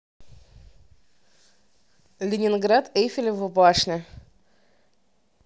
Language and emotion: Russian, neutral